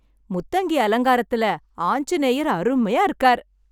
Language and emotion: Tamil, happy